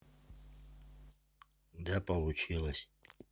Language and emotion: Russian, neutral